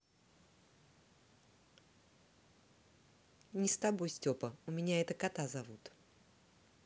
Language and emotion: Russian, neutral